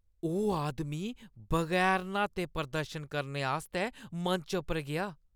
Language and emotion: Dogri, disgusted